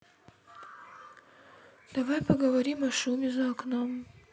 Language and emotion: Russian, sad